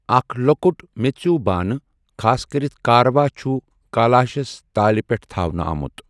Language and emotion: Kashmiri, neutral